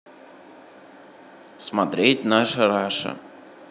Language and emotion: Russian, neutral